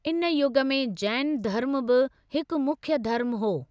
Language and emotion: Sindhi, neutral